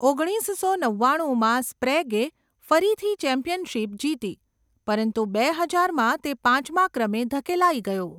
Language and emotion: Gujarati, neutral